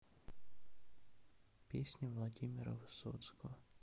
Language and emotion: Russian, sad